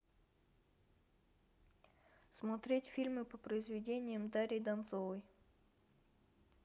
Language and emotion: Russian, neutral